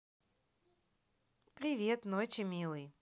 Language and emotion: Russian, positive